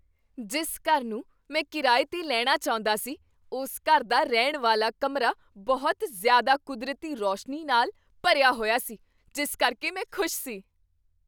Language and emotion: Punjabi, surprised